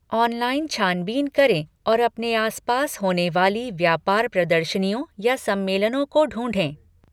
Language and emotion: Hindi, neutral